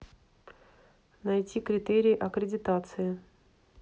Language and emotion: Russian, neutral